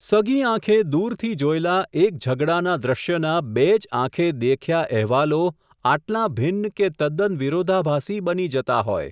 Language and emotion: Gujarati, neutral